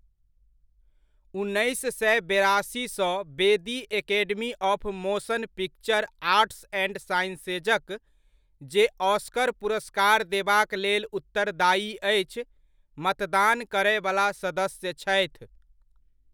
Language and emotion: Maithili, neutral